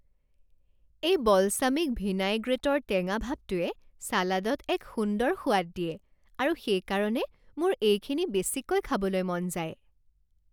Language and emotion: Assamese, happy